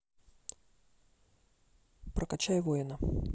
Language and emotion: Russian, neutral